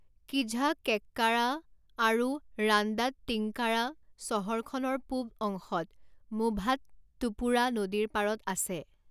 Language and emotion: Assamese, neutral